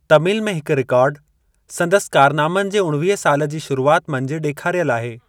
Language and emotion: Sindhi, neutral